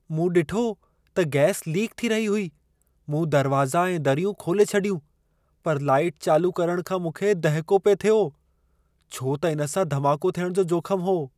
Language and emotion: Sindhi, fearful